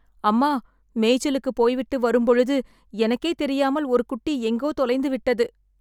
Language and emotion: Tamil, sad